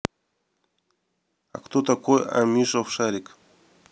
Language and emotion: Russian, neutral